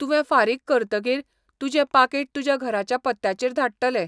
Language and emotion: Goan Konkani, neutral